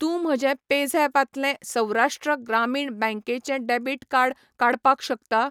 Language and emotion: Goan Konkani, neutral